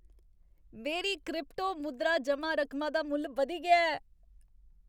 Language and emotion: Dogri, happy